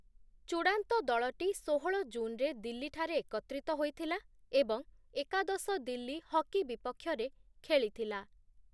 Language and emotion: Odia, neutral